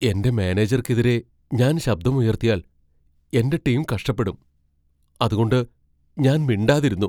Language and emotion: Malayalam, fearful